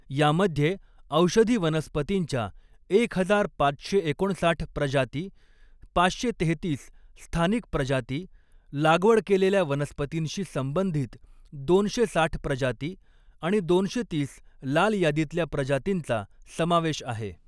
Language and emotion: Marathi, neutral